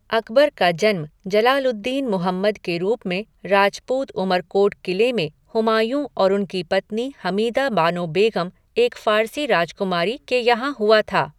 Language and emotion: Hindi, neutral